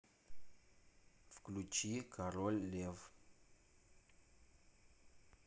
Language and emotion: Russian, neutral